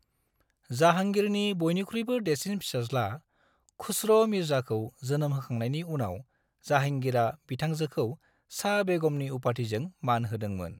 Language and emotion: Bodo, neutral